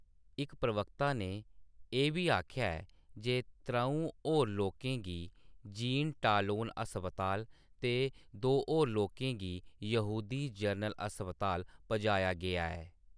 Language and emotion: Dogri, neutral